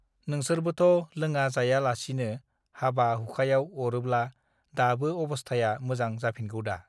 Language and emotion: Bodo, neutral